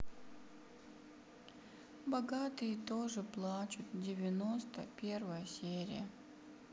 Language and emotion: Russian, sad